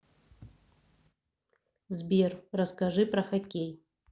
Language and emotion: Russian, neutral